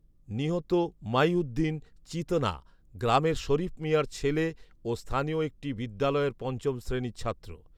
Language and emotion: Bengali, neutral